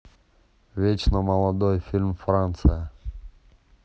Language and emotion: Russian, neutral